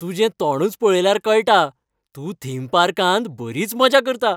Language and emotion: Goan Konkani, happy